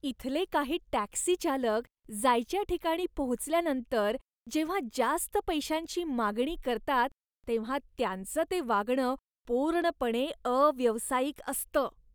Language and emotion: Marathi, disgusted